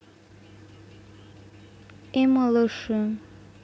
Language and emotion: Russian, sad